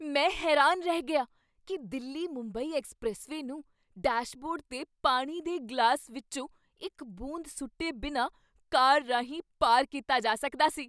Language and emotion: Punjabi, surprised